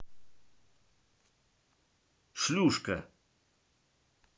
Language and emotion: Russian, angry